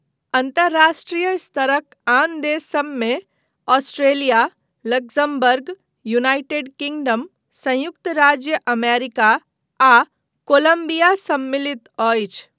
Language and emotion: Maithili, neutral